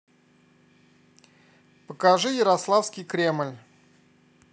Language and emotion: Russian, neutral